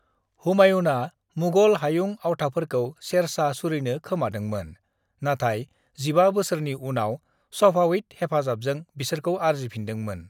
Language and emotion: Bodo, neutral